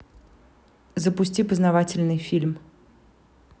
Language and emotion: Russian, neutral